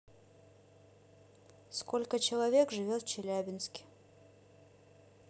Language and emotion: Russian, neutral